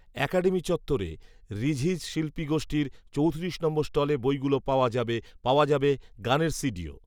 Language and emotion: Bengali, neutral